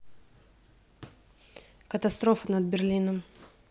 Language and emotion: Russian, neutral